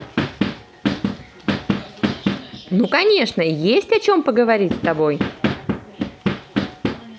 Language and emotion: Russian, positive